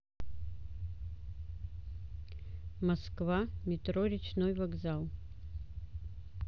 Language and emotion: Russian, neutral